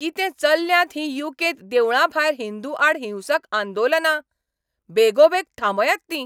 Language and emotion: Goan Konkani, angry